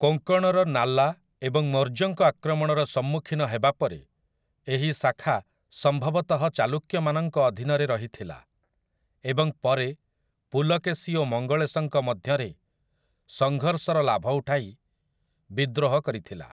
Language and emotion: Odia, neutral